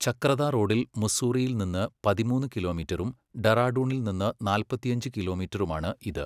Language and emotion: Malayalam, neutral